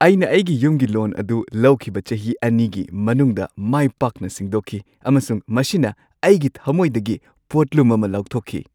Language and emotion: Manipuri, happy